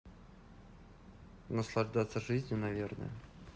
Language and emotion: Russian, neutral